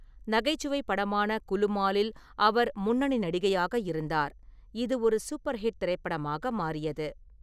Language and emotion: Tamil, neutral